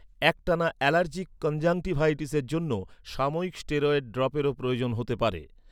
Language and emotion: Bengali, neutral